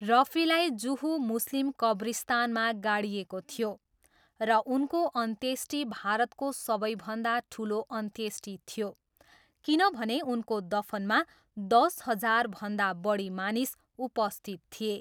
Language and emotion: Nepali, neutral